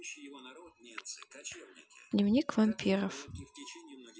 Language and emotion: Russian, neutral